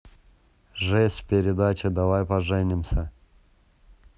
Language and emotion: Russian, neutral